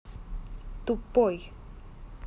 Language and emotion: Russian, angry